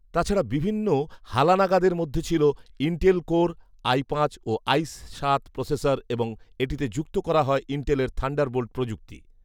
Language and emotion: Bengali, neutral